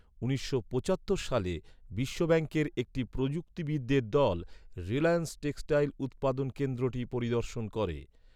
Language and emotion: Bengali, neutral